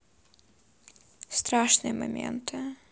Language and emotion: Russian, sad